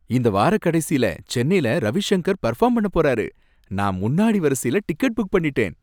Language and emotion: Tamil, happy